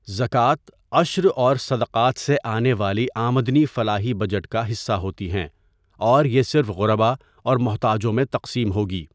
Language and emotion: Urdu, neutral